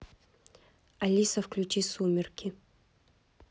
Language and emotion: Russian, neutral